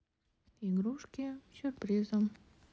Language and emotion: Russian, neutral